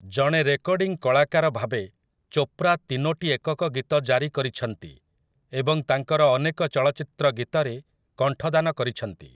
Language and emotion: Odia, neutral